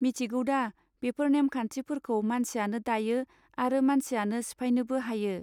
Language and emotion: Bodo, neutral